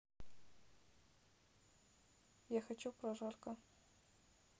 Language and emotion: Russian, neutral